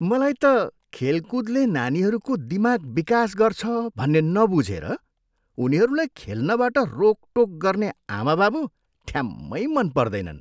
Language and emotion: Nepali, disgusted